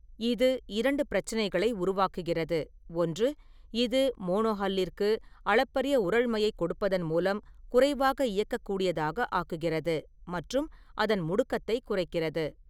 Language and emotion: Tamil, neutral